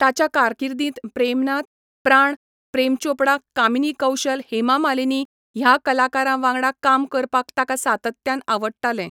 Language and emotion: Goan Konkani, neutral